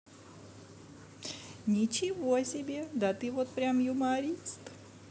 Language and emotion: Russian, positive